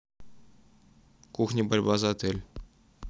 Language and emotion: Russian, neutral